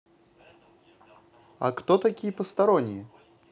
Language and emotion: Russian, positive